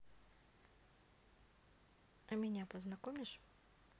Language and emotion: Russian, neutral